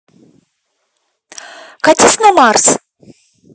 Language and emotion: Russian, angry